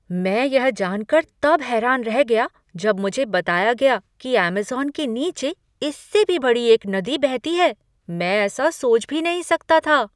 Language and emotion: Hindi, surprised